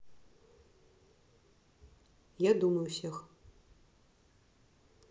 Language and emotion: Russian, neutral